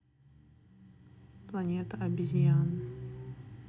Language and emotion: Russian, neutral